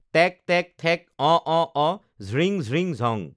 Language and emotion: Assamese, neutral